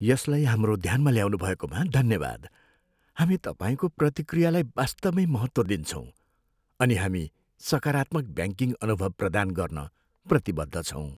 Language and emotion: Nepali, sad